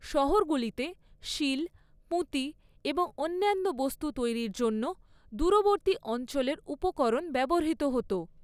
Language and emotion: Bengali, neutral